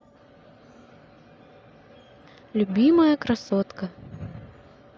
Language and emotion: Russian, neutral